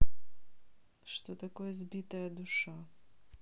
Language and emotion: Russian, neutral